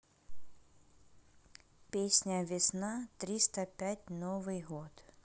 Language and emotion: Russian, neutral